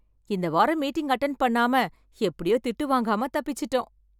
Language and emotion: Tamil, happy